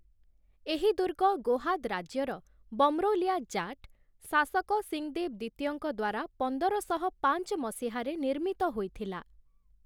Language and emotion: Odia, neutral